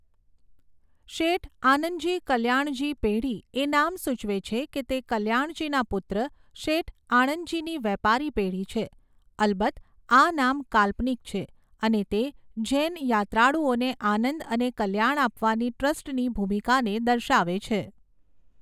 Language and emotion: Gujarati, neutral